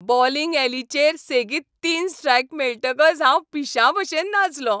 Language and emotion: Goan Konkani, happy